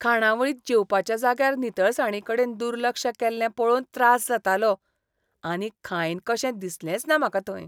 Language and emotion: Goan Konkani, disgusted